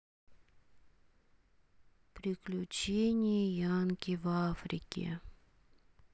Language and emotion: Russian, sad